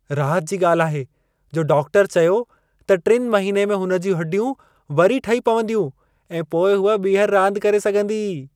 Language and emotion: Sindhi, happy